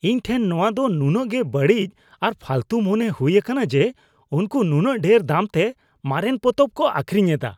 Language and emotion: Santali, disgusted